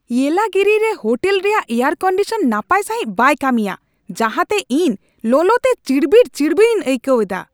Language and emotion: Santali, angry